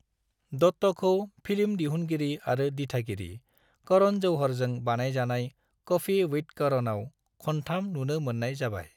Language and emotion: Bodo, neutral